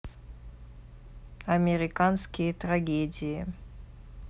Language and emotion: Russian, neutral